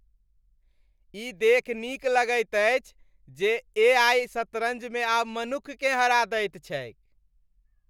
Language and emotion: Maithili, happy